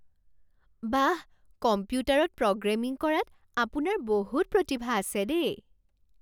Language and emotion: Assamese, surprised